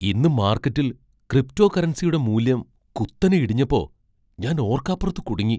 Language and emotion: Malayalam, surprised